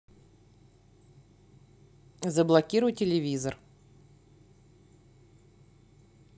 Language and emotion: Russian, neutral